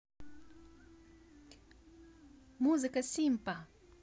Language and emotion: Russian, positive